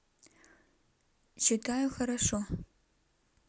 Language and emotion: Russian, neutral